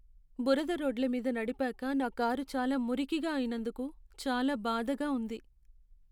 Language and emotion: Telugu, sad